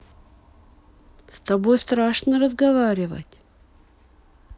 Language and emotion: Russian, neutral